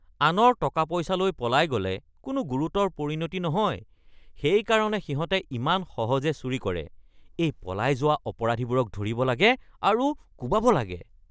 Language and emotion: Assamese, disgusted